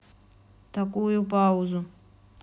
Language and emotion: Russian, neutral